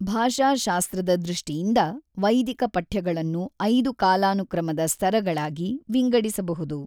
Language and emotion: Kannada, neutral